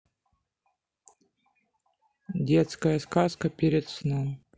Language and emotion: Russian, neutral